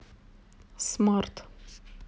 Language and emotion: Russian, neutral